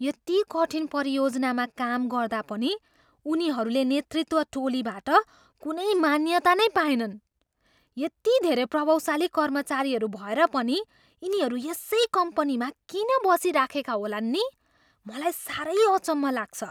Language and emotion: Nepali, surprised